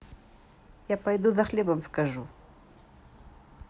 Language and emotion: Russian, neutral